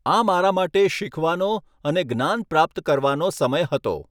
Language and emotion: Gujarati, neutral